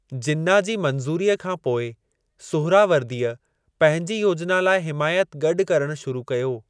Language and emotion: Sindhi, neutral